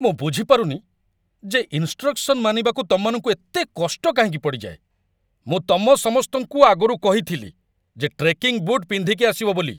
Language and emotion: Odia, angry